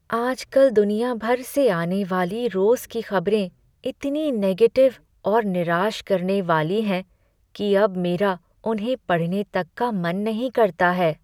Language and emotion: Hindi, sad